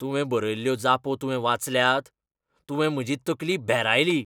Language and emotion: Goan Konkani, angry